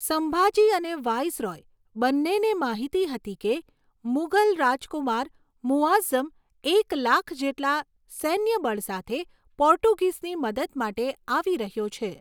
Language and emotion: Gujarati, neutral